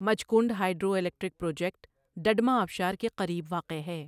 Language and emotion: Urdu, neutral